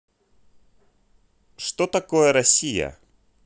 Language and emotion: Russian, neutral